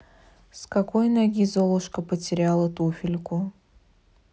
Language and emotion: Russian, neutral